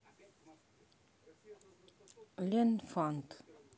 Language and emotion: Russian, neutral